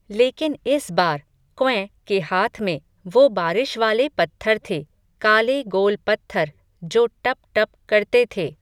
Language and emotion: Hindi, neutral